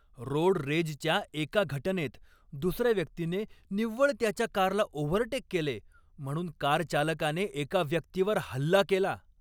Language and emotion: Marathi, angry